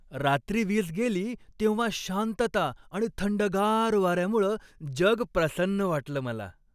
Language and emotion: Marathi, happy